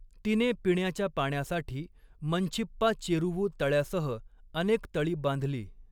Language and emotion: Marathi, neutral